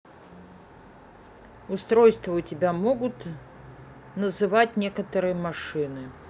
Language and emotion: Russian, neutral